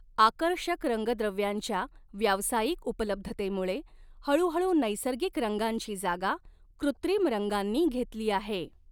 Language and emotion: Marathi, neutral